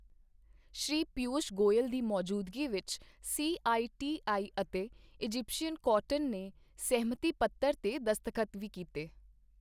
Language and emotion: Punjabi, neutral